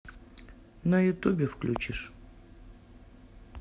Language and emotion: Russian, neutral